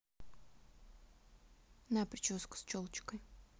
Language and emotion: Russian, neutral